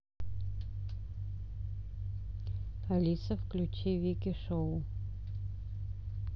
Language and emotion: Russian, neutral